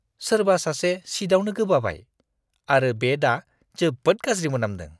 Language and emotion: Bodo, disgusted